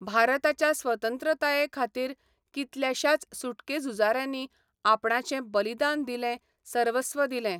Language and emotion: Goan Konkani, neutral